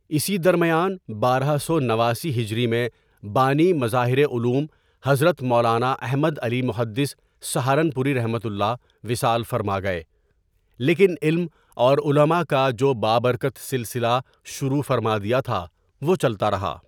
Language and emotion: Urdu, neutral